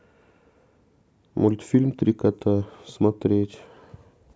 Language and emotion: Russian, neutral